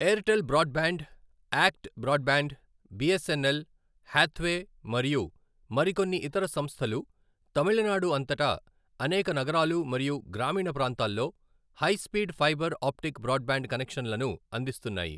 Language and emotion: Telugu, neutral